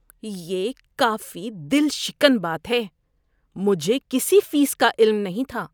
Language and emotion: Urdu, disgusted